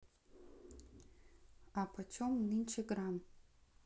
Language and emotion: Russian, neutral